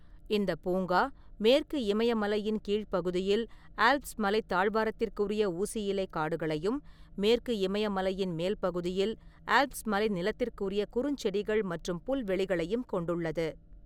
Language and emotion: Tamil, neutral